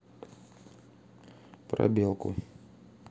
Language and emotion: Russian, neutral